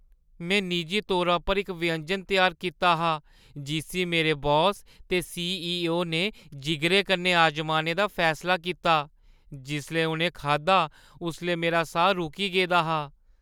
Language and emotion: Dogri, fearful